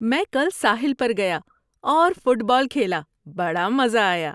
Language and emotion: Urdu, happy